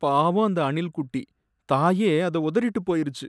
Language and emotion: Tamil, sad